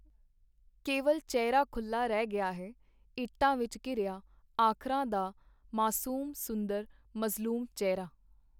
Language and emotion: Punjabi, neutral